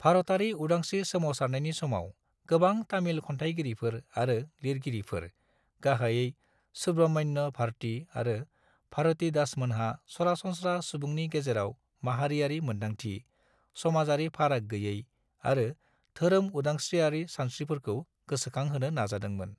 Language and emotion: Bodo, neutral